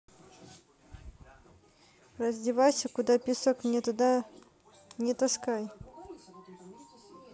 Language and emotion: Russian, neutral